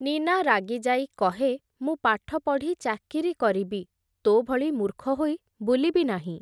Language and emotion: Odia, neutral